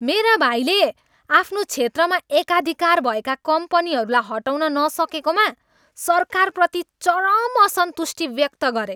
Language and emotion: Nepali, angry